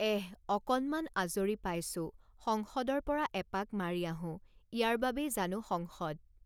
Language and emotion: Assamese, neutral